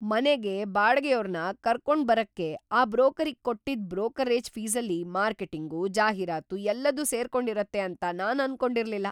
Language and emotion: Kannada, surprised